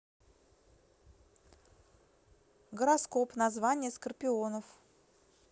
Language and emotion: Russian, neutral